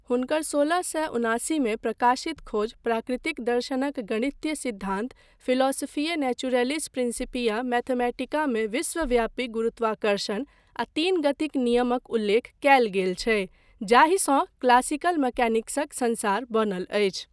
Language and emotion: Maithili, neutral